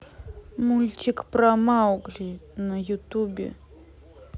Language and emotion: Russian, neutral